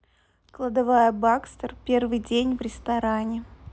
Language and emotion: Russian, neutral